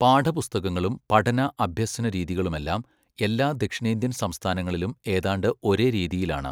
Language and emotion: Malayalam, neutral